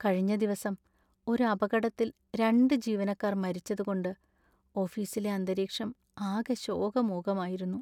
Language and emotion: Malayalam, sad